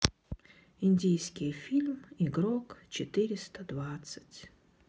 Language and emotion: Russian, sad